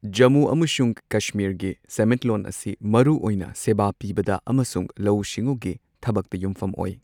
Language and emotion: Manipuri, neutral